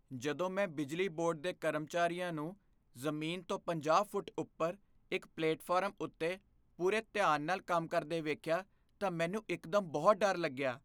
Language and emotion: Punjabi, fearful